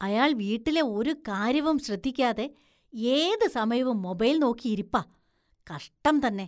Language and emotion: Malayalam, disgusted